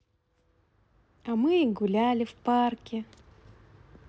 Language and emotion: Russian, positive